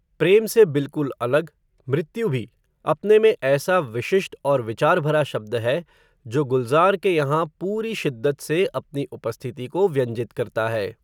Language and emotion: Hindi, neutral